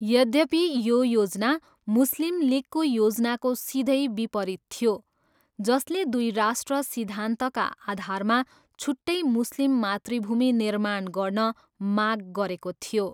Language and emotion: Nepali, neutral